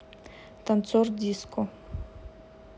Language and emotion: Russian, neutral